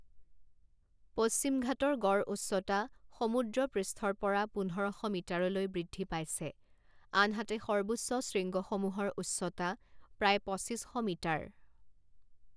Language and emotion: Assamese, neutral